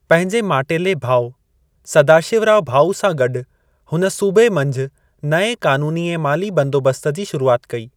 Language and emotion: Sindhi, neutral